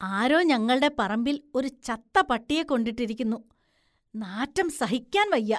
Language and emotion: Malayalam, disgusted